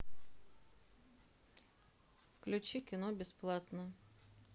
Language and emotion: Russian, neutral